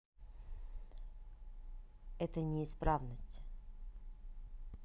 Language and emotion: Russian, neutral